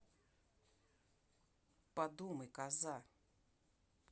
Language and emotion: Russian, angry